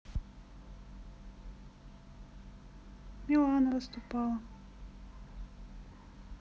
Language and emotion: Russian, sad